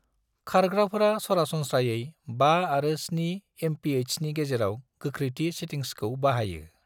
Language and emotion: Bodo, neutral